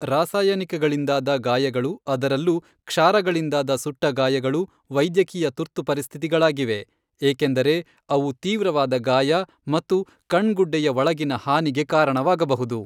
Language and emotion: Kannada, neutral